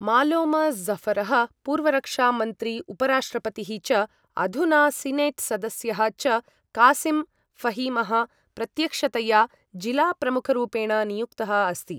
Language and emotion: Sanskrit, neutral